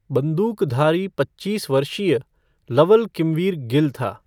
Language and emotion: Hindi, neutral